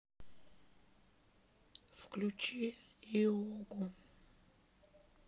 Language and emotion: Russian, sad